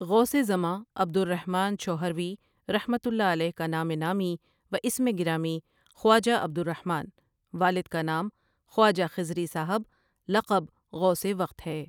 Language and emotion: Urdu, neutral